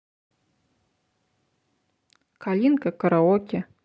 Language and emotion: Russian, neutral